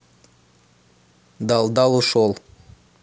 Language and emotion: Russian, neutral